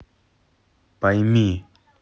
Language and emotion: Russian, neutral